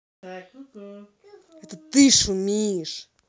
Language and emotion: Russian, angry